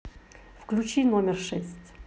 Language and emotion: Russian, neutral